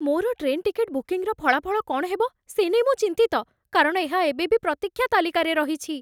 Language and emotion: Odia, fearful